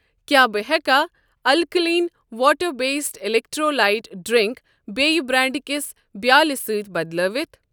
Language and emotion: Kashmiri, neutral